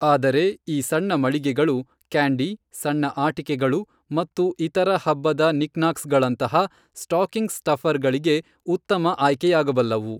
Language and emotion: Kannada, neutral